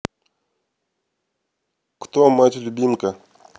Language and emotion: Russian, neutral